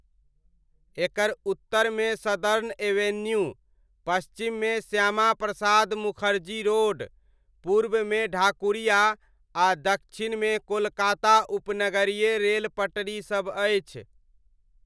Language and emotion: Maithili, neutral